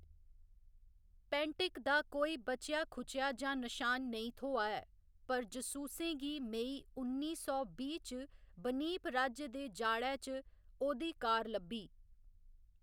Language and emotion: Dogri, neutral